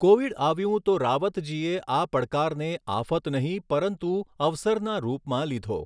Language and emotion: Gujarati, neutral